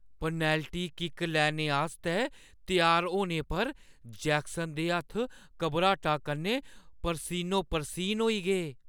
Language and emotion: Dogri, fearful